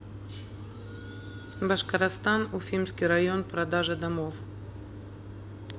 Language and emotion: Russian, neutral